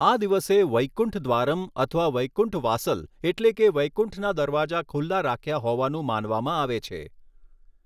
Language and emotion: Gujarati, neutral